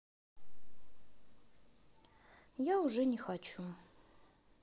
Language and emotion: Russian, neutral